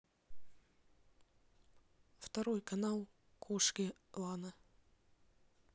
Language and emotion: Russian, neutral